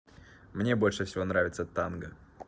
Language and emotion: Russian, positive